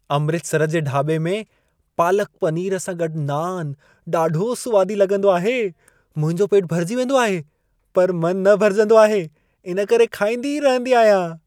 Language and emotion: Sindhi, happy